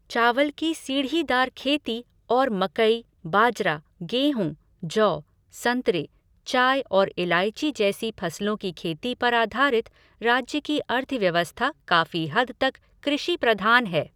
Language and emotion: Hindi, neutral